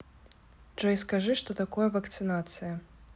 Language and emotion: Russian, neutral